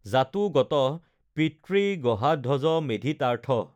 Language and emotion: Assamese, neutral